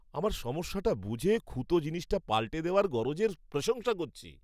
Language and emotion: Bengali, happy